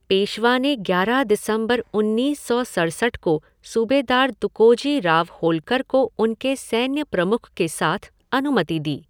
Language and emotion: Hindi, neutral